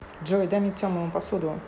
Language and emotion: Russian, neutral